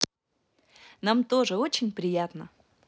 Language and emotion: Russian, positive